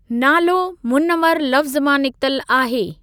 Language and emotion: Sindhi, neutral